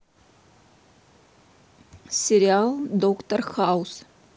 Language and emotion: Russian, neutral